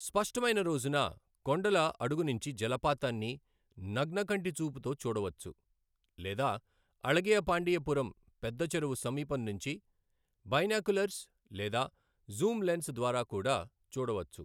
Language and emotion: Telugu, neutral